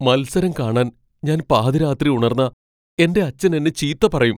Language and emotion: Malayalam, fearful